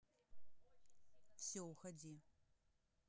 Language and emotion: Russian, neutral